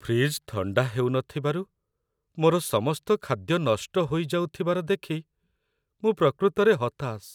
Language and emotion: Odia, sad